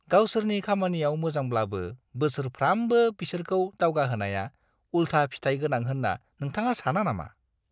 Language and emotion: Bodo, disgusted